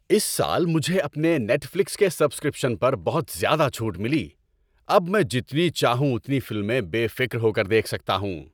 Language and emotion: Urdu, happy